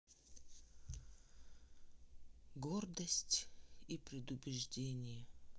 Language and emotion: Russian, sad